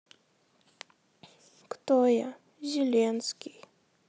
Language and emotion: Russian, sad